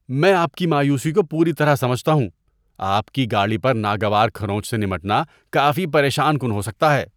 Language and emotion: Urdu, disgusted